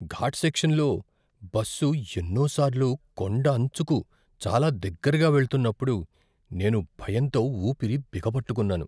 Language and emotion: Telugu, fearful